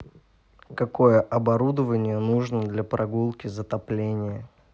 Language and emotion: Russian, neutral